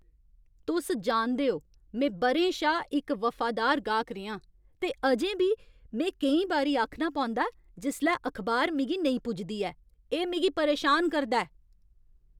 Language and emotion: Dogri, angry